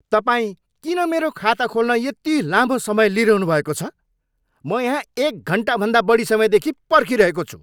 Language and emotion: Nepali, angry